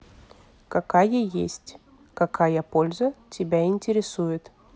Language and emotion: Russian, neutral